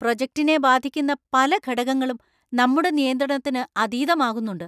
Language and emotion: Malayalam, angry